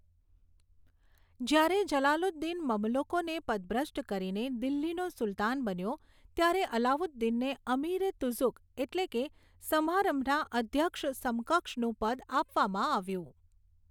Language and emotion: Gujarati, neutral